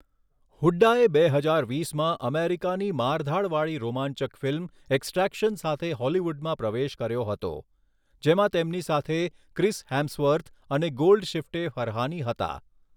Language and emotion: Gujarati, neutral